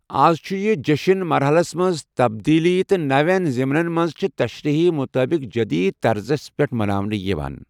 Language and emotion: Kashmiri, neutral